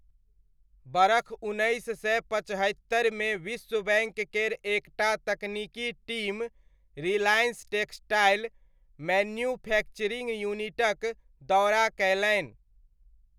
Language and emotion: Maithili, neutral